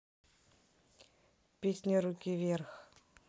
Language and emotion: Russian, neutral